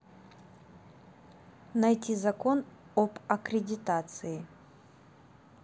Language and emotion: Russian, neutral